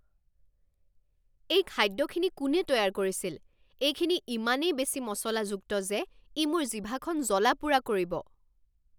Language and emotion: Assamese, angry